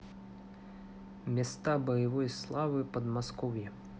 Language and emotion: Russian, neutral